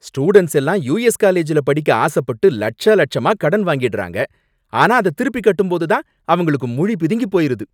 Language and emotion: Tamil, angry